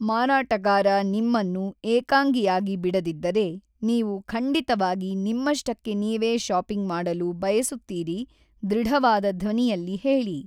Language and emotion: Kannada, neutral